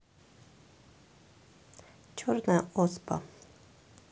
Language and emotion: Russian, neutral